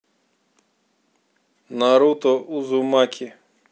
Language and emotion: Russian, neutral